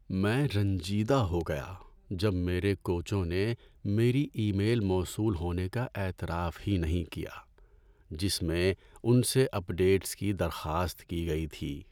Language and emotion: Urdu, sad